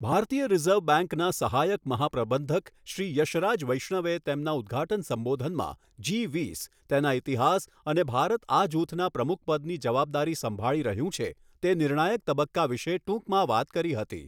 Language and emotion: Gujarati, neutral